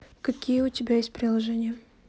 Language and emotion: Russian, neutral